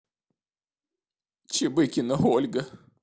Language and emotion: Russian, sad